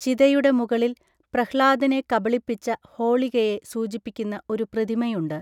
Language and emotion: Malayalam, neutral